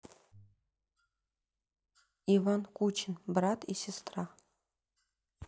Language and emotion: Russian, neutral